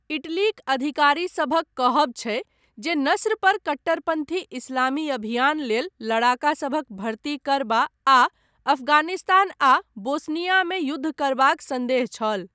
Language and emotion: Maithili, neutral